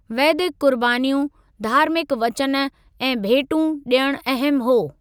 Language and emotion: Sindhi, neutral